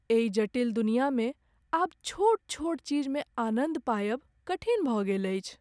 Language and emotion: Maithili, sad